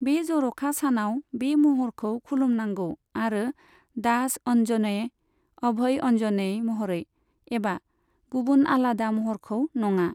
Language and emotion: Bodo, neutral